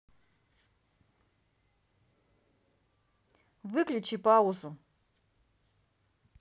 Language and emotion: Russian, angry